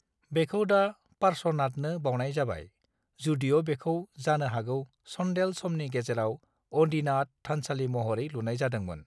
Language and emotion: Bodo, neutral